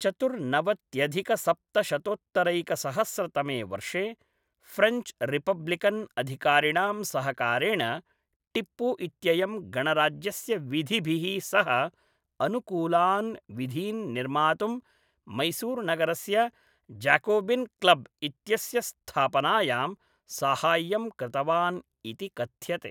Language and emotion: Sanskrit, neutral